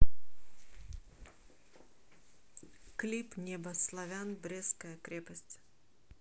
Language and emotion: Russian, neutral